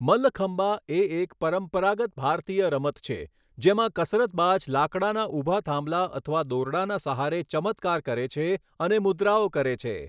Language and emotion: Gujarati, neutral